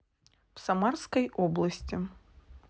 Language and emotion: Russian, neutral